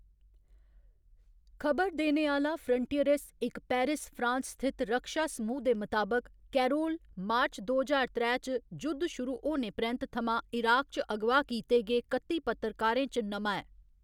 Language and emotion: Dogri, neutral